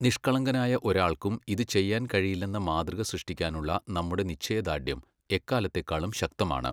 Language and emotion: Malayalam, neutral